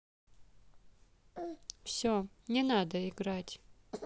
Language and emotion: Russian, neutral